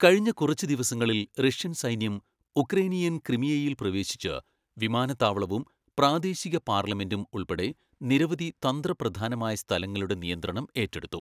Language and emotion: Malayalam, neutral